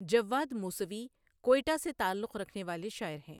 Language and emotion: Urdu, neutral